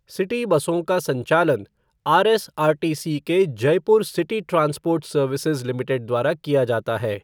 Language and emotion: Hindi, neutral